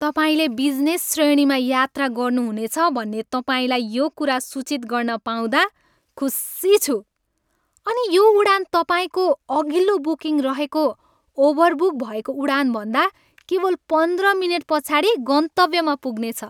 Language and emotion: Nepali, happy